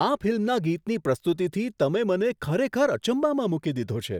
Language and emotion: Gujarati, surprised